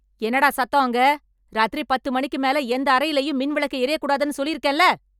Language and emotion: Tamil, angry